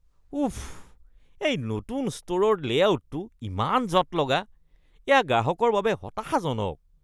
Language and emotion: Assamese, disgusted